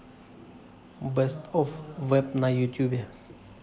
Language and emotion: Russian, neutral